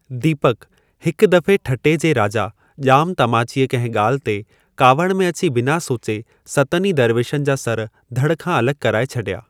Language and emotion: Sindhi, neutral